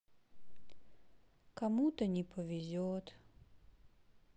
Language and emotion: Russian, sad